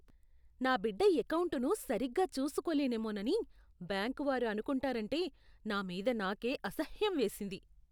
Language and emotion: Telugu, disgusted